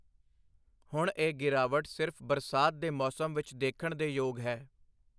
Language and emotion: Punjabi, neutral